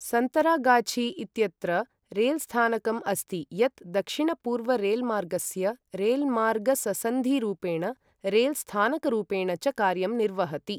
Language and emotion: Sanskrit, neutral